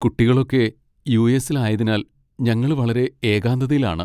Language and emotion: Malayalam, sad